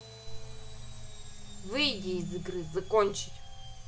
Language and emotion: Russian, angry